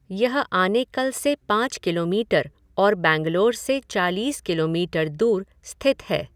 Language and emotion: Hindi, neutral